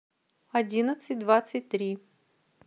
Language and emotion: Russian, neutral